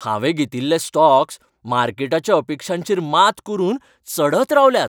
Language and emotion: Goan Konkani, happy